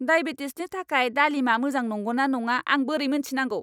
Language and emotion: Bodo, angry